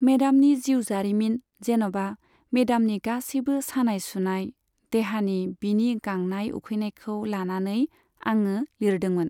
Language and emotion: Bodo, neutral